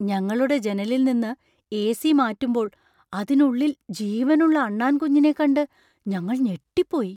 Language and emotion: Malayalam, surprised